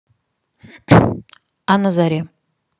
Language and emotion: Russian, neutral